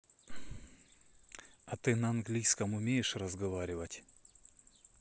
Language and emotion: Russian, neutral